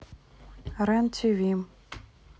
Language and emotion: Russian, neutral